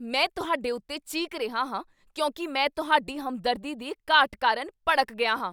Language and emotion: Punjabi, angry